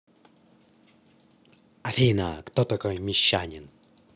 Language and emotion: Russian, neutral